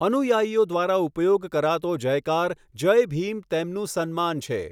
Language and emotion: Gujarati, neutral